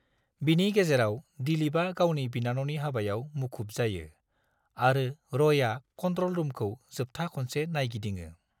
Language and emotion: Bodo, neutral